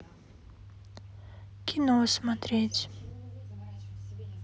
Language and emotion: Russian, sad